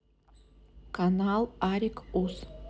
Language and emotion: Russian, neutral